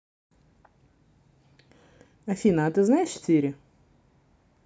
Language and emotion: Russian, neutral